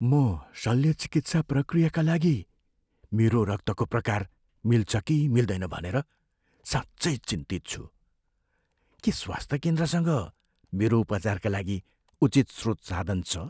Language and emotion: Nepali, fearful